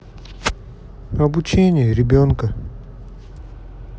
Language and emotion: Russian, sad